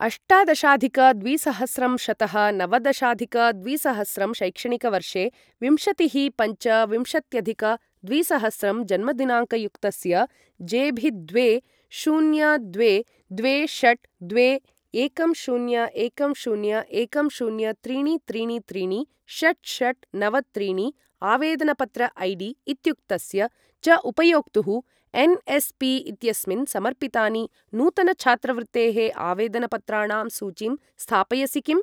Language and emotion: Sanskrit, neutral